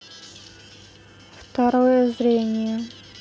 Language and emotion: Russian, neutral